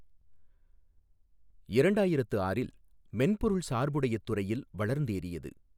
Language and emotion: Tamil, neutral